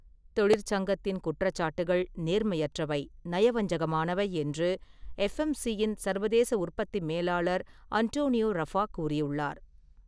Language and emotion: Tamil, neutral